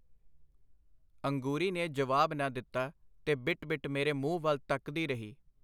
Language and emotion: Punjabi, neutral